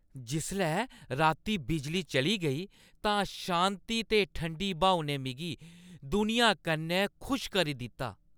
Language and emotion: Dogri, happy